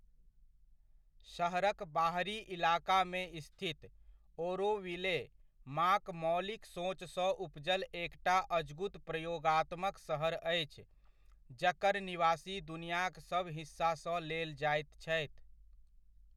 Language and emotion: Maithili, neutral